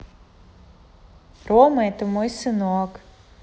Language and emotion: Russian, positive